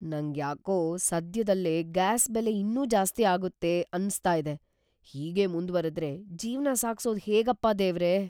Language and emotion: Kannada, fearful